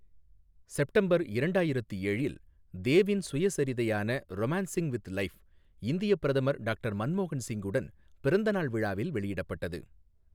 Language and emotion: Tamil, neutral